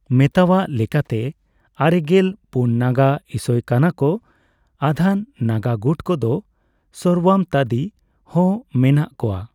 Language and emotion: Santali, neutral